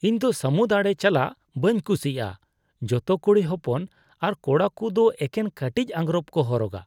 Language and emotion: Santali, disgusted